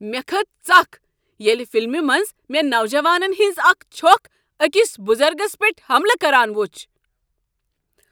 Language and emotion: Kashmiri, angry